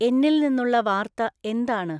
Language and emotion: Malayalam, neutral